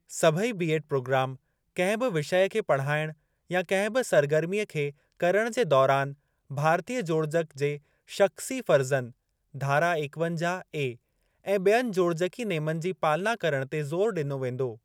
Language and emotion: Sindhi, neutral